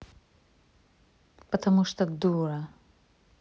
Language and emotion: Russian, angry